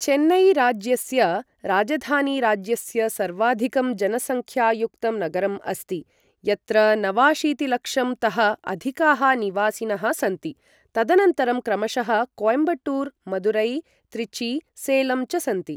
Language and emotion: Sanskrit, neutral